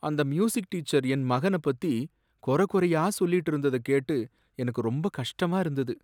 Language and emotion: Tamil, sad